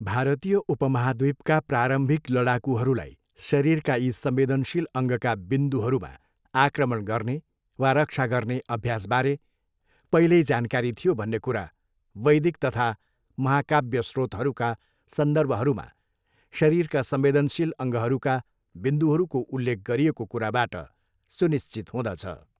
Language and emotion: Nepali, neutral